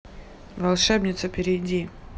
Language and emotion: Russian, neutral